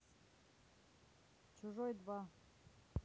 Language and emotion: Russian, neutral